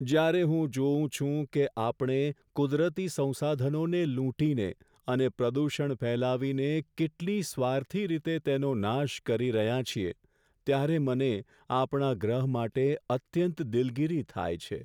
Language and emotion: Gujarati, sad